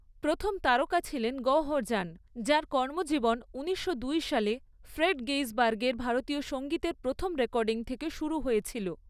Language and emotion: Bengali, neutral